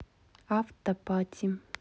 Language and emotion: Russian, neutral